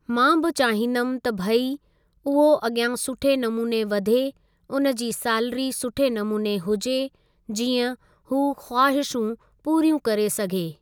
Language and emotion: Sindhi, neutral